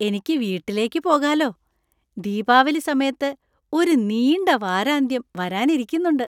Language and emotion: Malayalam, happy